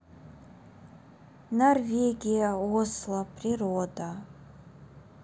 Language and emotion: Russian, neutral